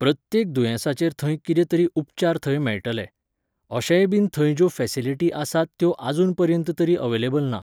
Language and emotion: Goan Konkani, neutral